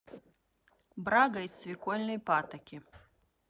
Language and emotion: Russian, neutral